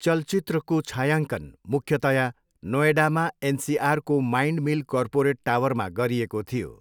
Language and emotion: Nepali, neutral